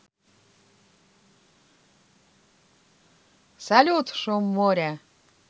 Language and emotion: Russian, positive